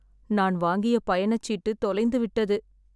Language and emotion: Tamil, sad